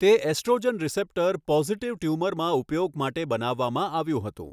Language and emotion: Gujarati, neutral